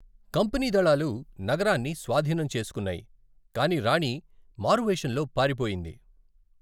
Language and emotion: Telugu, neutral